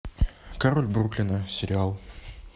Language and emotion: Russian, neutral